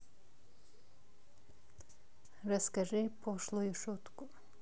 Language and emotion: Russian, neutral